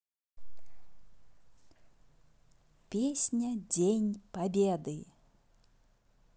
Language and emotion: Russian, positive